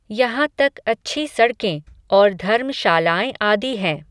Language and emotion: Hindi, neutral